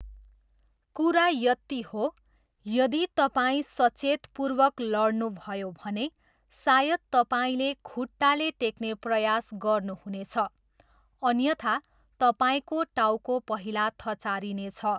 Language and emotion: Nepali, neutral